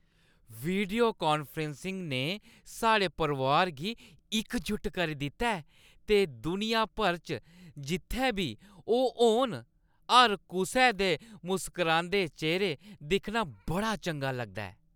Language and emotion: Dogri, happy